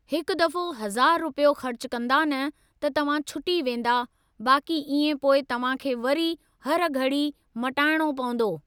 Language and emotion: Sindhi, neutral